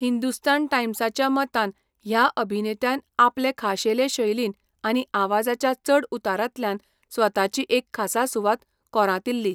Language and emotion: Goan Konkani, neutral